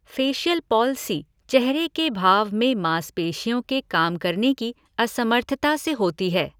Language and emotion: Hindi, neutral